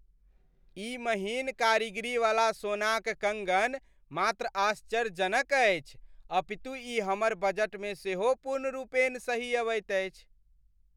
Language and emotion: Maithili, happy